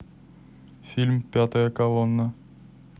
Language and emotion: Russian, neutral